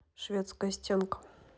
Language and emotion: Russian, neutral